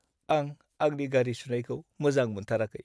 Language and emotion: Bodo, sad